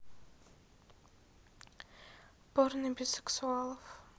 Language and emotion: Russian, neutral